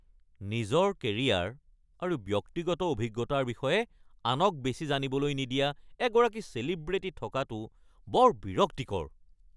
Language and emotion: Assamese, angry